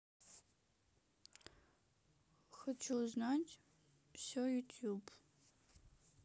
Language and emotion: Russian, sad